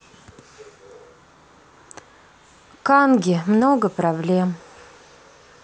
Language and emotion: Russian, sad